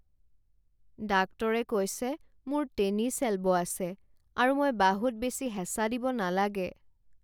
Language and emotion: Assamese, sad